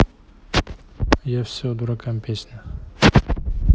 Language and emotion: Russian, neutral